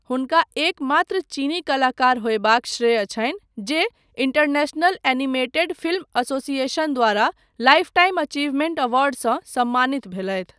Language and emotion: Maithili, neutral